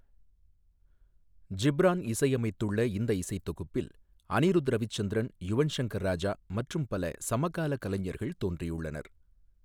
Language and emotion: Tamil, neutral